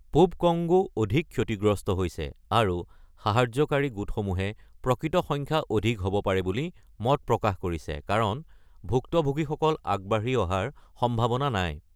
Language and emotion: Assamese, neutral